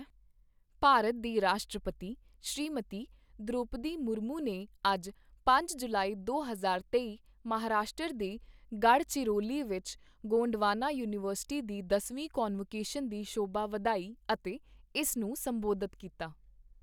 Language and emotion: Punjabi, neutral